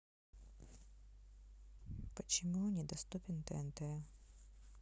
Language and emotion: Russian, sad